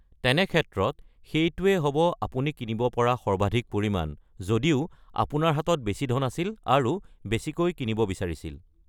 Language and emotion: Assamese, neutral